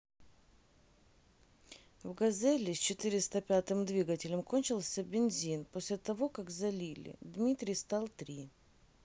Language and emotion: Russian, neutral